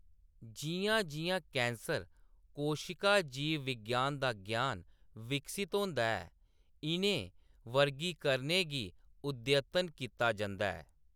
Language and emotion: Dogri, neutral